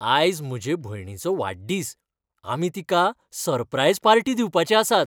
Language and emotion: Goan Konkani, happy